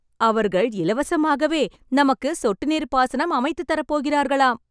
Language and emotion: Tamil, happy